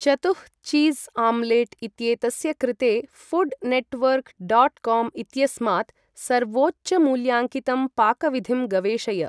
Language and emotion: Sanskrit, neutral